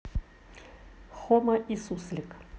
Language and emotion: Russian, neutral